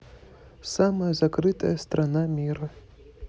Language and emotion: Russian, neutral